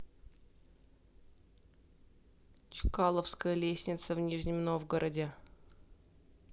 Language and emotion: Russian, neutral